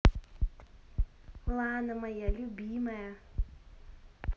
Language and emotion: Russian, positive